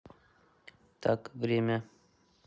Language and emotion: Russian, neutral